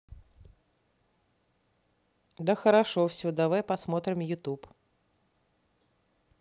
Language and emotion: Russian, neutral